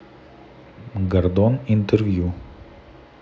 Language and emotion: Russian, neutral